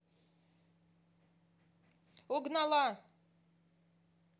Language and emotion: Russian, neutral